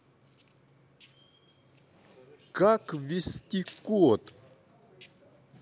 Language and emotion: Russian, neutral